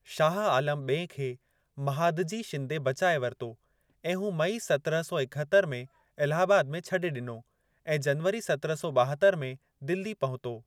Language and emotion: Sindhi, neutral